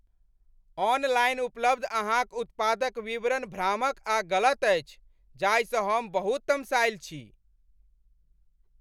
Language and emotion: Maithili, angry